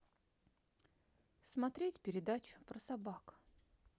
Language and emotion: Russian, neutral